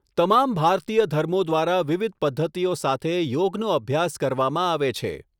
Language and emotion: Gujarati, neutral